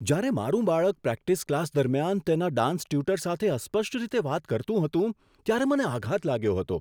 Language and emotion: Gujarati, surprised